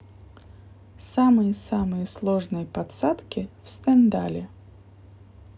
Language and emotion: Russian, neutral